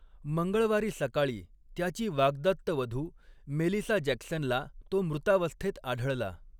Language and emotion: Marathi, neutral